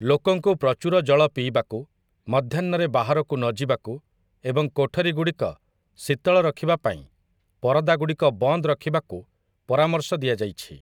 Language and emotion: Odia, neutral